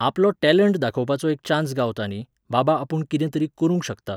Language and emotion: Goan Konkani, neutral